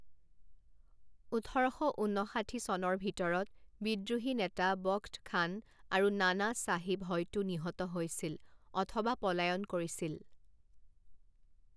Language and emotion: Assamese, neutral